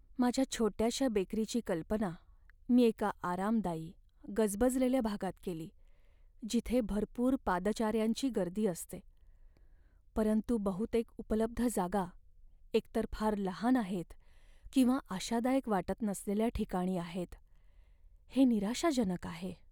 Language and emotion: Marathi, sad